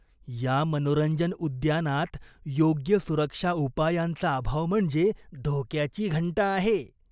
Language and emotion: Marathi, disgusted